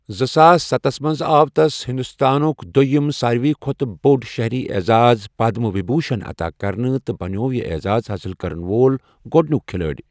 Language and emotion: Kashmiri, neutral